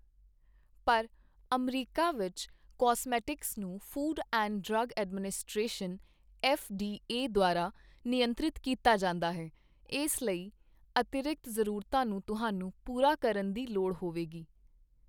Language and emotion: Punjabi, neutral